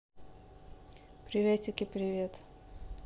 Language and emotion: Russian, neutral